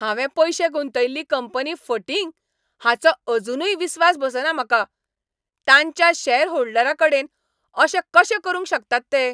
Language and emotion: Goan Konkani, angry